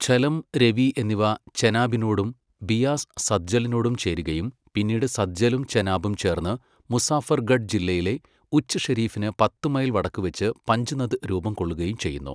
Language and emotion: Malayalam, neutral